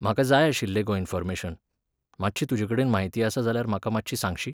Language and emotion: Goan Konkani, neutral